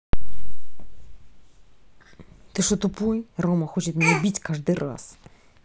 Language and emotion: Russian, angry